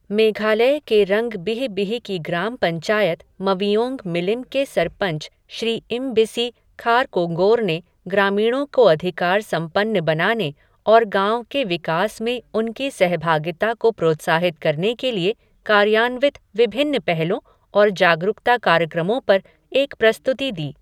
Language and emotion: Hindi, neutral